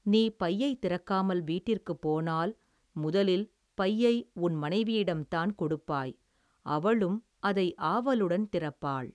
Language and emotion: Tamil, neutral